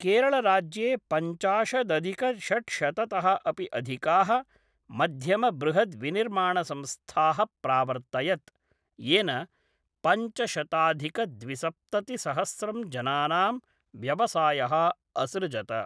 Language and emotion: Sanskrit, neutral